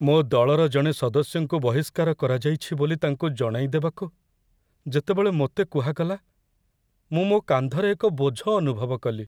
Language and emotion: Odia, sad